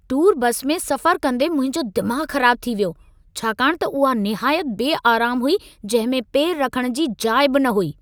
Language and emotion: Sindhi, angry